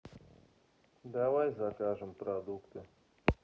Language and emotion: Russian, neutral